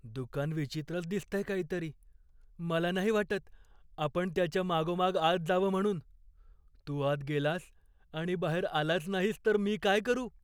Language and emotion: Marathi, fearful